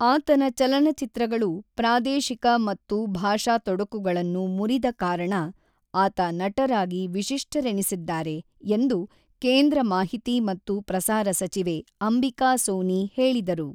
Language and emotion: Kannada, neutral